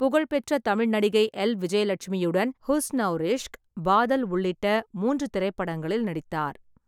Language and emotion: Tamil, neutral